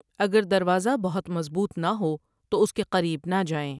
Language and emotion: Urdu, neutral